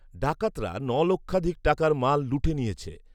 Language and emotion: Bengali, neutral